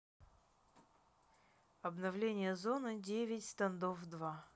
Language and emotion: Russian, neutral